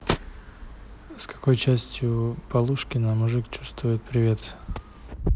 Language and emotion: Russian, neutral